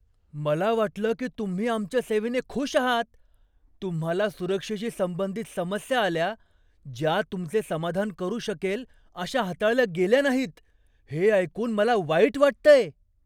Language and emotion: Marathi, surprised